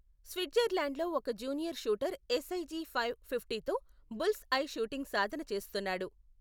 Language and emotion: Telugu, neutral